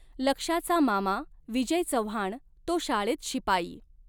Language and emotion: Marathi, neutral